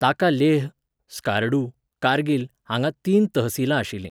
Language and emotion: Goan Konkani, neutral